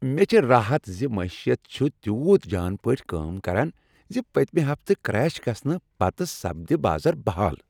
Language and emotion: Kashmiri, happy